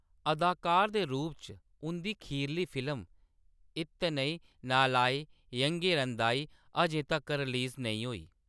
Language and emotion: Dogri, neutral